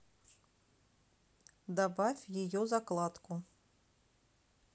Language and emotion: Russian, neutral